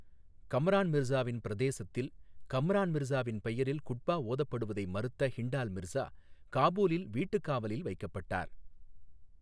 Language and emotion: Tamil, neutral